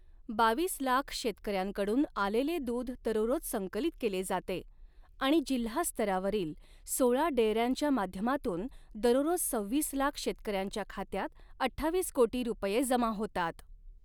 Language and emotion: Marathi, neutral